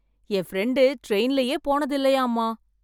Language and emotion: Tamil, surprised